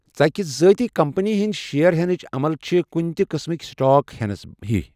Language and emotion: Kashmiri, neutral